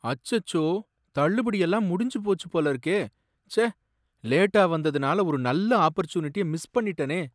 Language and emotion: Tamil, sad